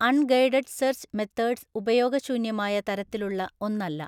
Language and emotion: Malayalam, neutral